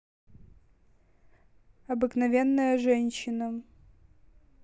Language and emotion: Russian, neutral